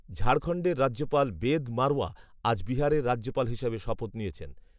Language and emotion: Bengali, neutral